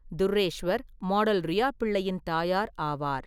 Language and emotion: Tamil, neutral